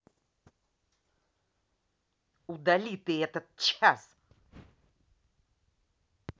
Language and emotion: Russian, angry